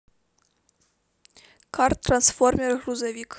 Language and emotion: Russian, neutral